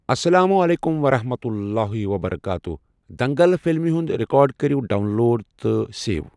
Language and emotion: Kashmiri, neutral